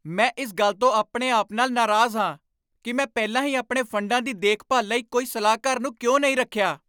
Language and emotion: Punjabi, angry